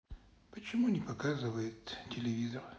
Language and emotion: Russian, sad